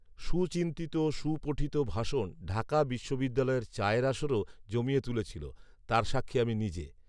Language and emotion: Bengali, neutral